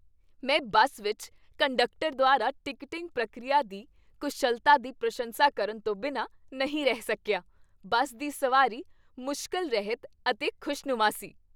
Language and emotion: Punjabi, happy